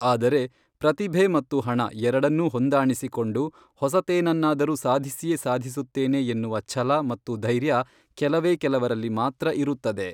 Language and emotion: Kannada, neutral